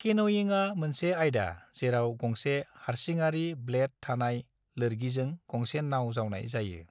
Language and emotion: Bodo, neutral